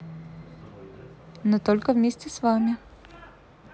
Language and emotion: Russian, positive